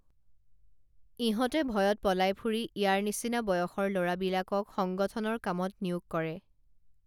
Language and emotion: Assamese, neutral